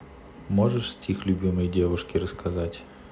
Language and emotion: Russian, neutral